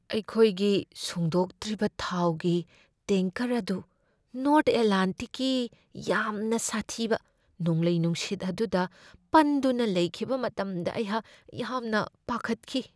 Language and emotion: Manipuri, fearful